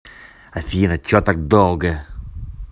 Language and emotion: Russian, angry